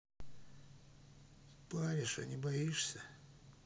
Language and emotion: Russian, neutral